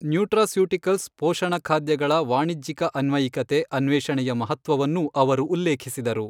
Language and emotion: Kannada, neutral